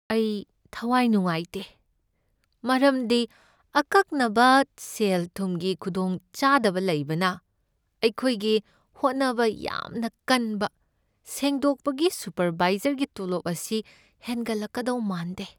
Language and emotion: Manipuri, sad